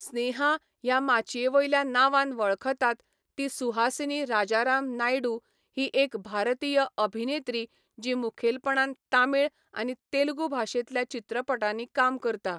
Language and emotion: Goan Konkani, neutral